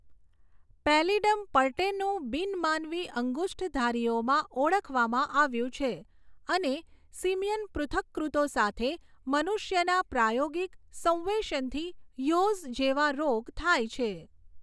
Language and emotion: Gujarati, neutral